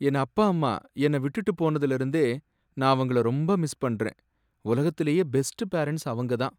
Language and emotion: Tamil, sad